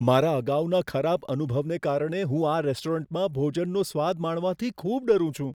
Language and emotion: Gujarati, fearful